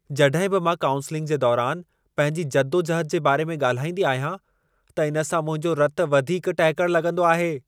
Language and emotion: Sindhi, angry